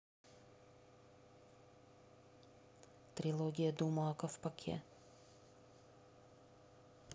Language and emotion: Russian, neutral